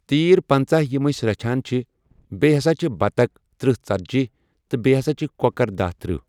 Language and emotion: Kashmiri, neutral